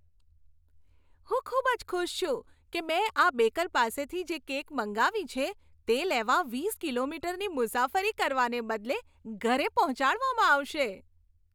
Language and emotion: Gujarati, happy